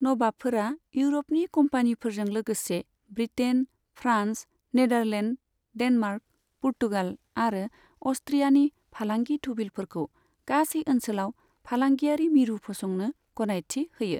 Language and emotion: Bodo, neutral